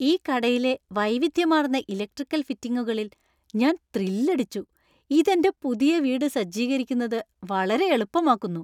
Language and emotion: Malayalam, happy